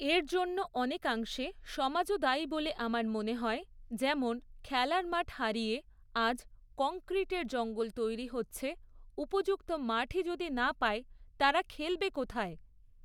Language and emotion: Bengali, neutral